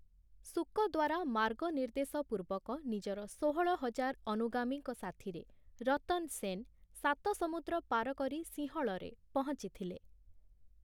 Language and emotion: Odia, neutral